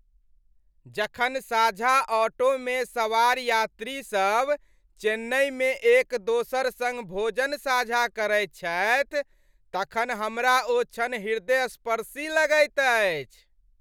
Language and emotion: Maithili, happy